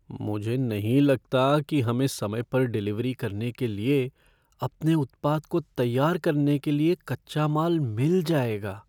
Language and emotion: Hindi, fearful